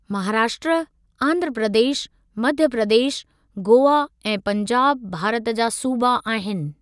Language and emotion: Sindhi, neutral